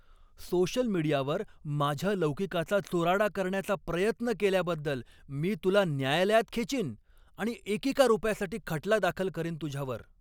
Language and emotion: Marathi, angry